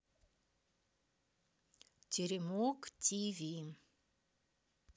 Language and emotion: Russian, neutral